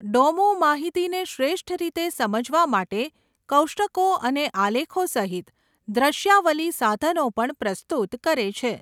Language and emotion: Gujarati, neutral